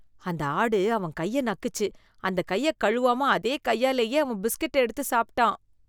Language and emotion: Tamil, disgusted